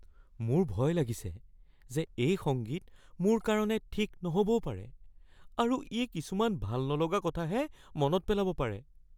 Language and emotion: Assamese, fearful